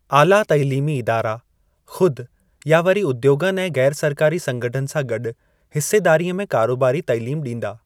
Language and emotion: Sindhi, neutral